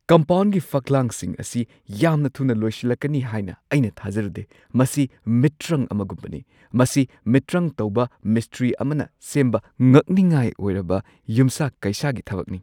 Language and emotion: Manipuri, surprised